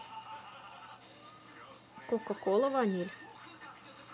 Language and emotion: Russian, neutral